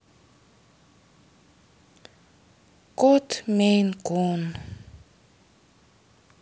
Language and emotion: Russian, sad